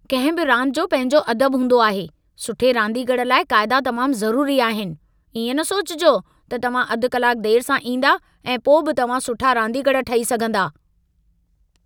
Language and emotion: Sindhi, angry